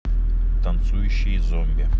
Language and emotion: Russian, neutral